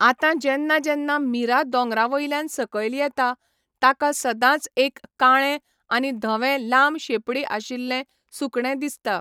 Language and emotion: Goan Konkani, neutral